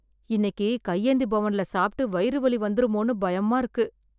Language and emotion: Tamil, fearful